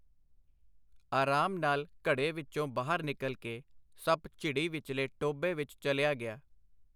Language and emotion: Punjabi, neutral